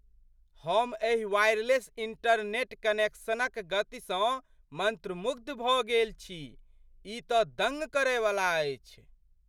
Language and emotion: Maithili, surprised